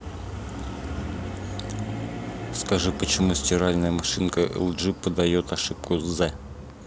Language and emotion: Russian, neutral